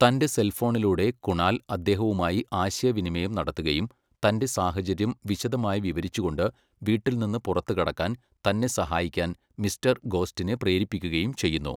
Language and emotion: Malayalam, neutral